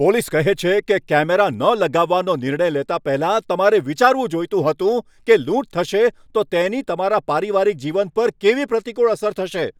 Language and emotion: Gujarati, angry